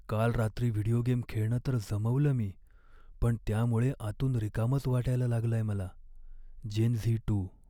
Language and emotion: Marathi, sad